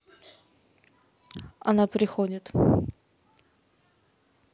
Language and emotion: Russian, neutral